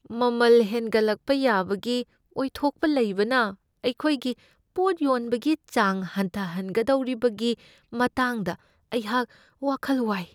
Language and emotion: Manipuri, fearful